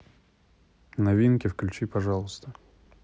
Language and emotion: Russian, neutral